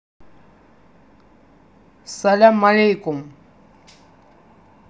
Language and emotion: Russian, neutral